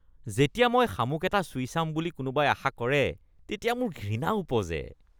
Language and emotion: Assamese, disgusted